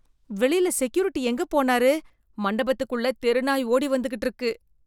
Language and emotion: Tamil, disgusted